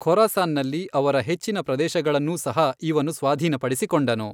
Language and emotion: Kannada, neutral